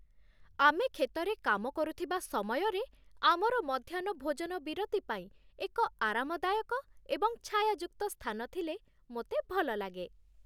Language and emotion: Odia, happy